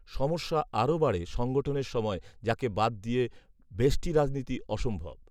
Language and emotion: Bengali, neutral